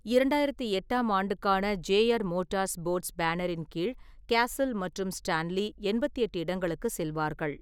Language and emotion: Tamil, neutral